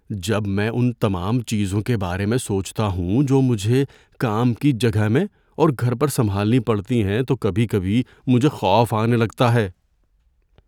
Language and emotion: Urdu, fearful